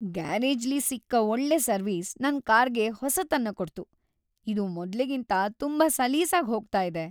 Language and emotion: Kannada, happy